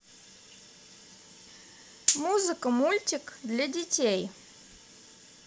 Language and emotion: Russian, positive